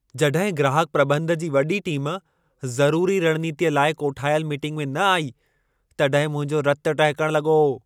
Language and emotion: Sindhi, angry